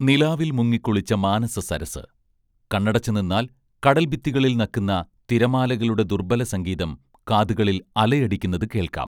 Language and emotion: Malayalam, neutral